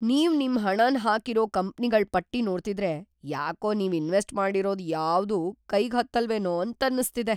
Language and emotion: Kannada, fearful